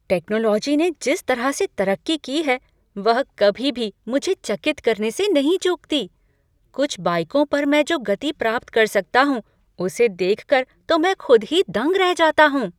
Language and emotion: Hindi, surprised